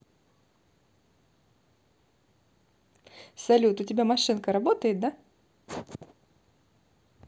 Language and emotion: Russian, positive